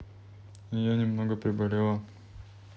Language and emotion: Russian, neutral